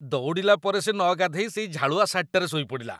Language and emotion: Odia, disgusted